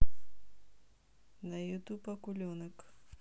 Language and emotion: Russian, neutral